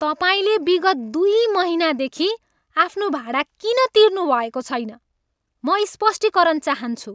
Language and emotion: Nepali, angry